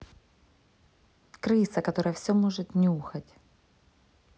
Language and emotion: Russian, neutral